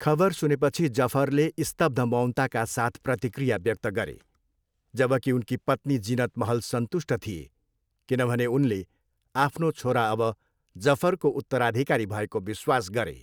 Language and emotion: Nepali, neutral